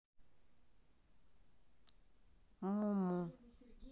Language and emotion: Russian, neutral